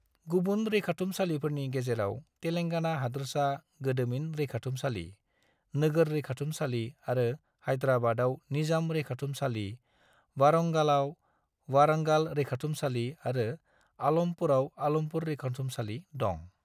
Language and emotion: Bodo, neutral